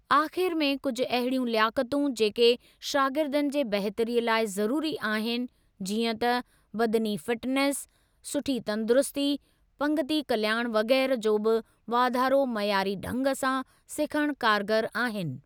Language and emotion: Sindhi, neutral